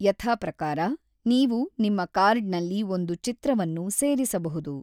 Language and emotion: Kannada, neutral